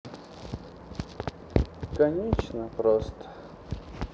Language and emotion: Russian, sad